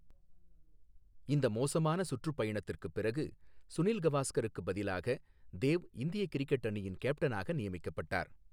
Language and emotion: Tamil, neutral